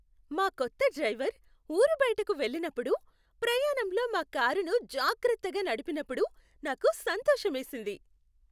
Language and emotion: Telugu, happy